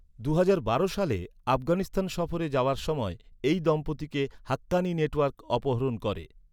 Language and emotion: Bengali, neutral